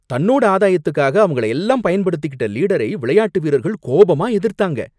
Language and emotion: Tamil, angry